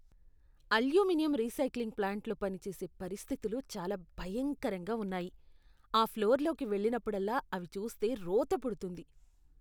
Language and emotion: Telugu, disgusted